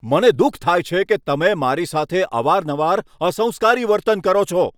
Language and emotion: Gujarati, angry